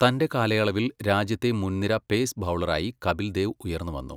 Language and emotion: Malayalam, neutral